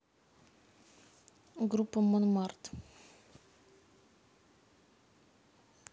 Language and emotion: Russian, neutral